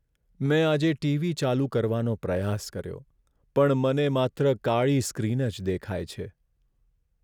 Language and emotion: Gujarati, sad